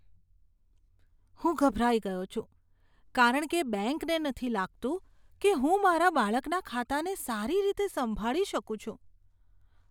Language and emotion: Gujarati, disgusted